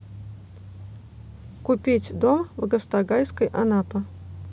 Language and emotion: Russian, neutral